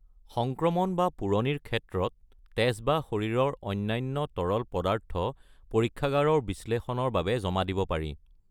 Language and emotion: Assamese, neutral